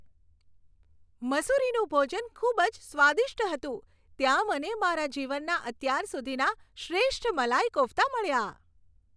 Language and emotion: Gujarati, happy